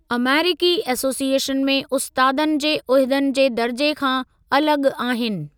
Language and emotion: Sindhi, neutral